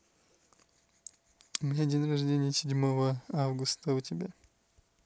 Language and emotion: Russian, neutral